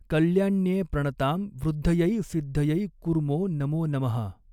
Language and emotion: Marathi, neutral